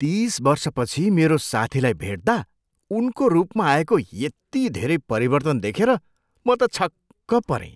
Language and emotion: Nepali, surprised